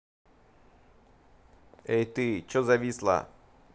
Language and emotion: Russian, angry